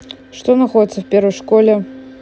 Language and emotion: Russian, neutral